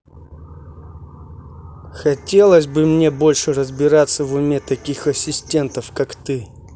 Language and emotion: Russian, angry